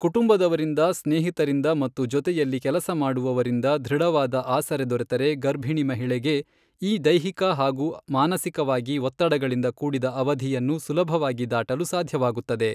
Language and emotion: Kannada, neutral